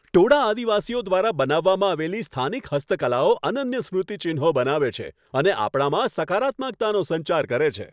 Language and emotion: Gujarati, happy